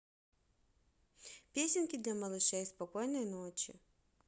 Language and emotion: Russian, positive